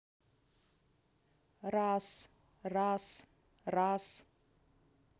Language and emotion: Russian, neutral